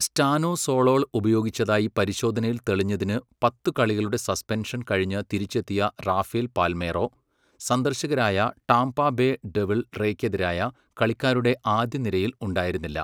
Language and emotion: Malayalam, neutral